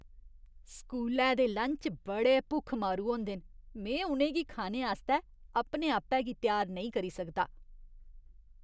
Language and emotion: Dogri, disgusted